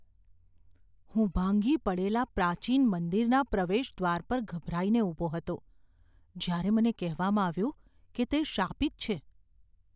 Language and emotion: Gujarati, fearful